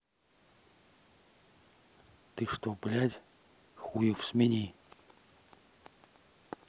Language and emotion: Russian, angry